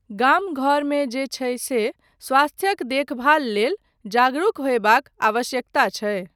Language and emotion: Maithili, neutral